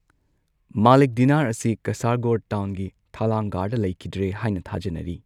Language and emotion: Manipuri, neutral